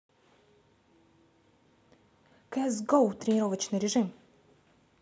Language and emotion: Russian, neutral